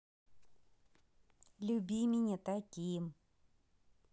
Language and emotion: Russian, positive